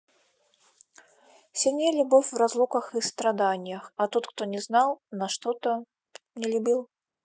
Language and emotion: Russian, neutral